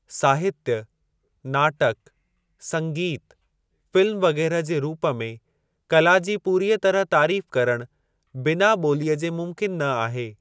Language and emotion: Sindhi, neutral